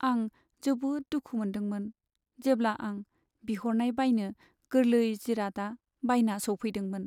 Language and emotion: Bodo, sad